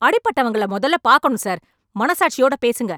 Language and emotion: Tamil, angry